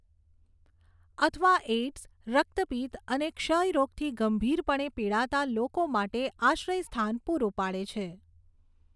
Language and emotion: Gujarati, neutral